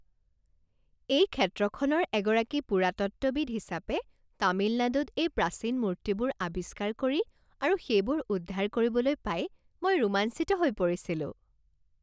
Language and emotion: Assamese, happy